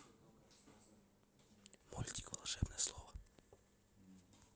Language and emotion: Russian, neutral